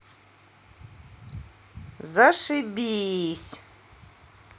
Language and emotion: Russian, angry